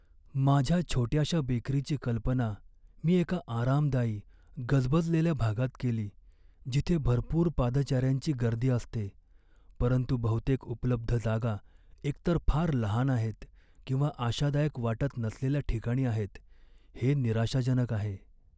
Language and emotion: Marathi, sad